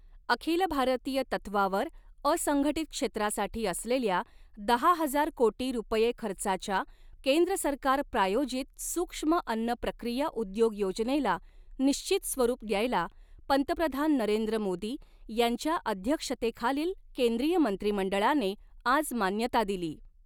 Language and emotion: Marathi, neutral